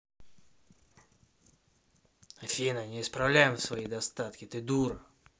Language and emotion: Russian, angry